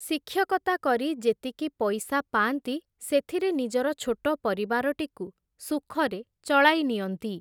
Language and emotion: Odia, neutral